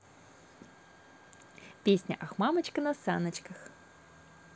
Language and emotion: Russian, positive